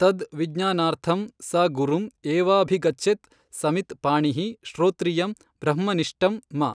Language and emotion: Kannada, neutral